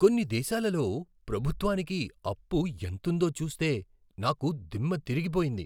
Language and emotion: Telugu, surprised